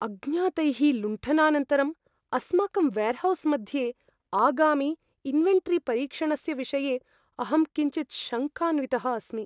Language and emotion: Sanskrit, fearful